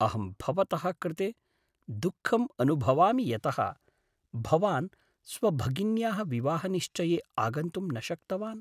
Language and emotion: Sanskrit, sad